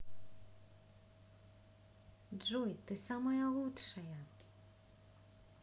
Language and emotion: Russian, positive